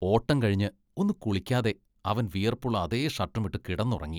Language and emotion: Malayalam, disgusted